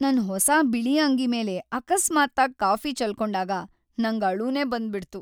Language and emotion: Kannada, sad